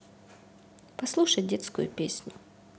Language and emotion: Russian, neutral